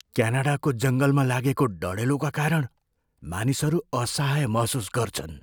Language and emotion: Nepali, fearful